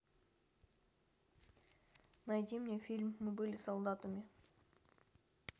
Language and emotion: Russian, neutral